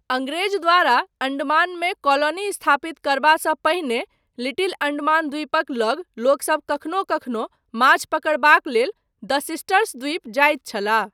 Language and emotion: Maithili, neutral